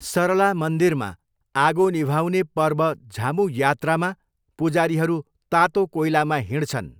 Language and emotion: Nepali, neutral